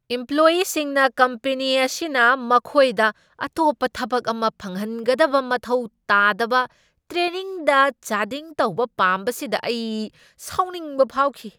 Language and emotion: Manipuri, angry